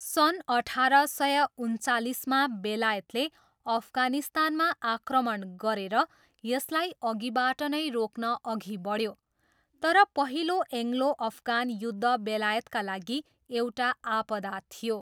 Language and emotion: Nepali, neutral